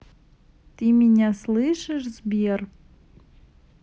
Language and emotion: Russian, neutral